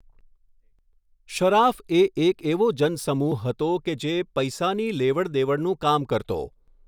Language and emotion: Gujarati, neutral